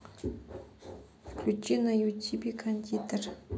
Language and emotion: Russian, neutral